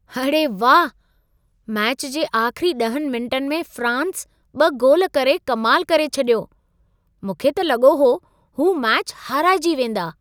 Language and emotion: Sindhi, surprised